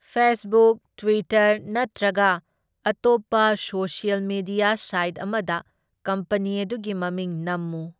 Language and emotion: Manipuri, neutral